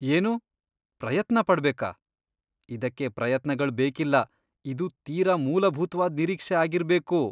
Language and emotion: Kannada, disgusted